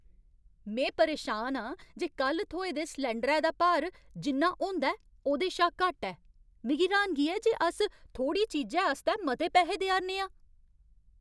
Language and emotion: Dogri, angry